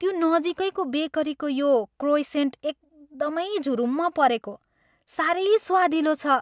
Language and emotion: Nepali, happy